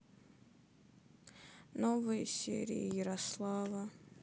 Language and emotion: Russian, sad